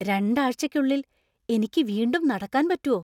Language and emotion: Malayalam, surprised